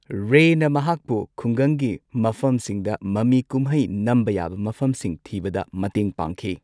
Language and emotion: Manipuri, neutral